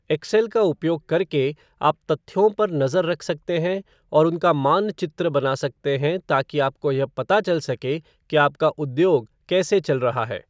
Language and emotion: Hindi, neutral